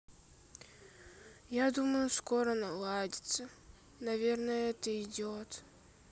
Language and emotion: Russian, sad